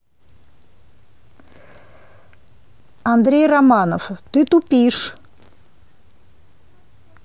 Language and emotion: Russian, angry